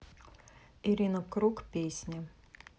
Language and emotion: Russian, neutral